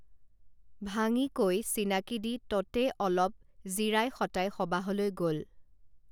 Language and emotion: Assamese, neutral